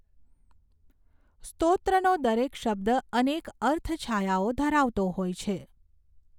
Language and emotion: Gujarati, neutral